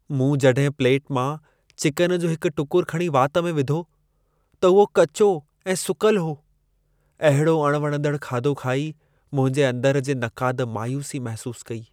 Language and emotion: Sindhi, sad